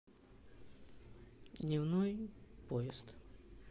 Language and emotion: Russian, neutral